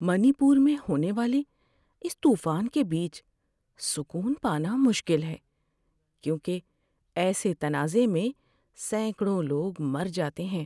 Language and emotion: Urdu, sad